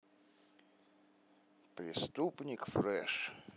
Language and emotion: Russian, neutral